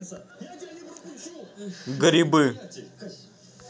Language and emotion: Russian, neutral